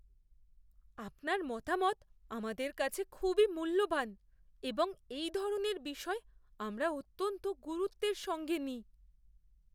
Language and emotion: Bengali, fearful